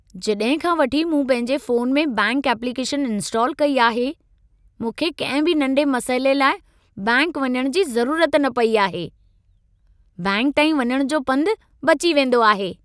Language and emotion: Sindhi, happy